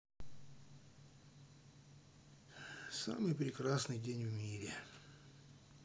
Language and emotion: Russian, sad